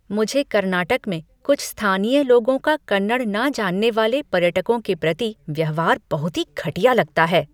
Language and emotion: Hindi, disgusted